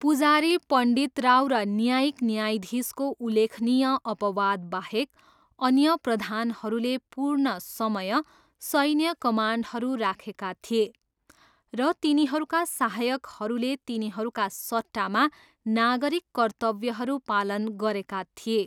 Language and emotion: Nepali, neutral